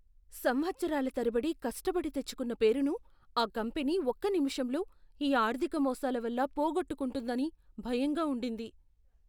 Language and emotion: Telugu, fearful